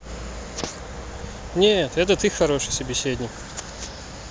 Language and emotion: Russian, neutral